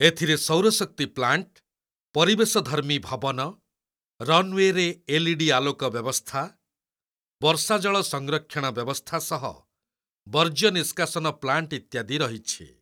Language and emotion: Odia, neutral